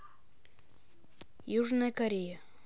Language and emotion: Russian, neutral